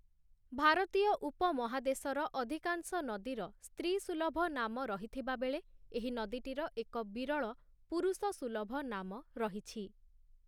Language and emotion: Odia, neutral